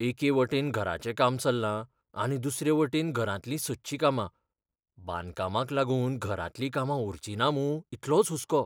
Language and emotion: Goan Konkani, fearful